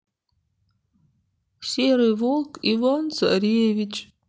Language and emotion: Russian, sad